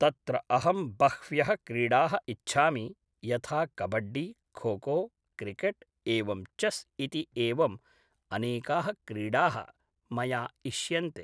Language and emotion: Sanskrit, neutral